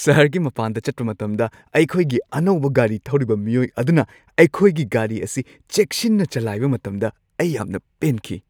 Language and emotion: Manipuri, happy